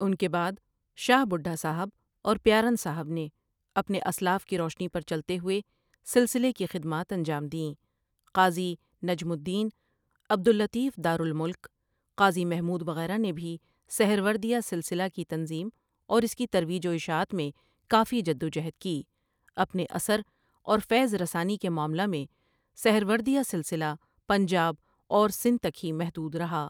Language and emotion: Urdu, neutral